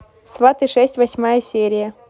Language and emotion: Russian, neutral